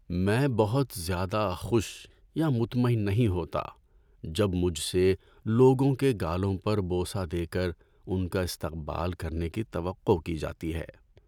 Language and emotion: Urdu, sad